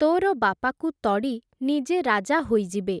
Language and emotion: Odia, neutral